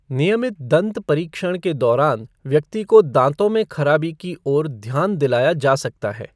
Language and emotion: Hindi, neutral